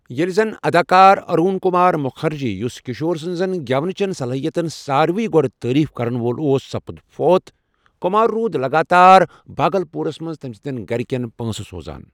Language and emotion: Kashmiri, neutral